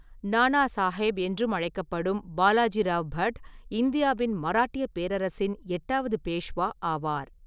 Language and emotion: Tamil, neutral